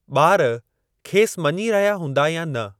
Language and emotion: Sindhi, neutral